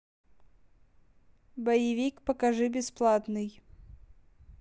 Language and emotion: Russian, neutral